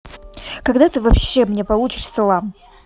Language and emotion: Russian, angry